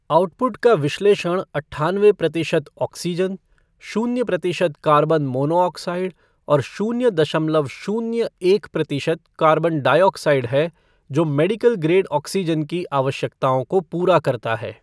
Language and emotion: Hindi, neutral